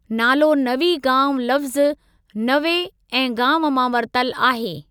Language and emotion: Sindhi, neutral